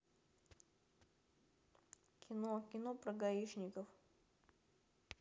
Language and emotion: Russian, neutral